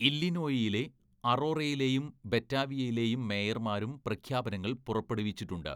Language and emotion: Malayalam, neutral